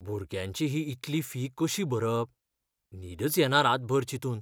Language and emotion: Goan Konkani, fearful